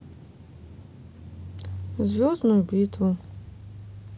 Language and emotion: Russian, neutral